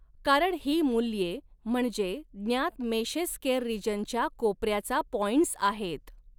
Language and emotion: Marathi, neutral